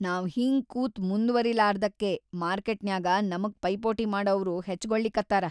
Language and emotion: Kannada, sad